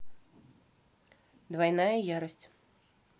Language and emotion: Russian, neutral